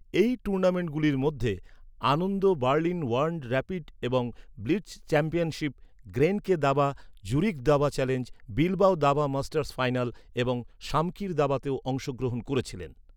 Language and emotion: Bengali, neutral